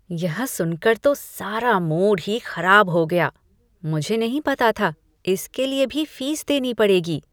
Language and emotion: Hindi, disgusted